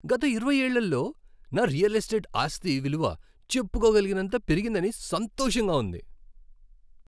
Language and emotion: Telugu, happy